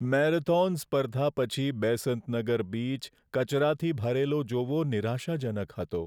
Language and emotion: Gujarati, sad